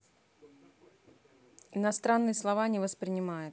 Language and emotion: Russian, neutral